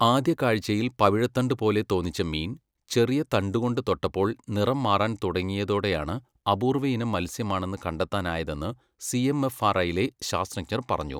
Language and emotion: Malayalam, neutral